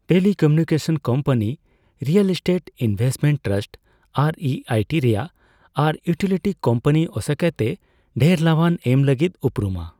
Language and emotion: Santali, neutral